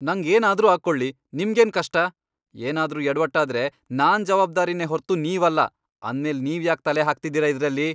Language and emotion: Kannada, angry